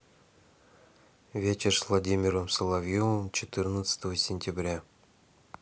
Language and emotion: Russian, neutral